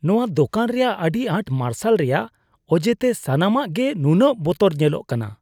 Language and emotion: Santali, disgusted